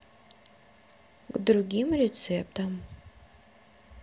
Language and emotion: Russian, neutral